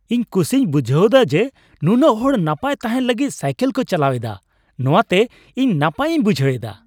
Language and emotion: Santali, happy